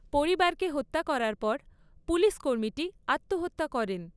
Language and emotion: Bengali, neutral